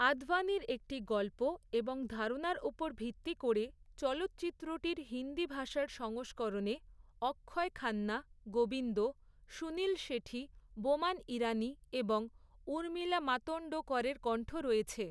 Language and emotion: Bengali, neutral